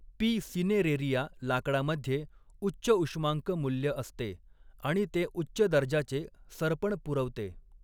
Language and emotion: Marathi, neutral